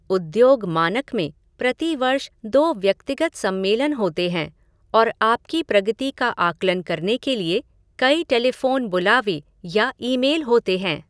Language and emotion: Hindi, neutral